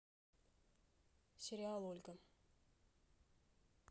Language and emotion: Russian, neutral